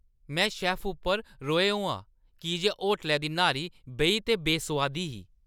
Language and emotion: Dogri, angry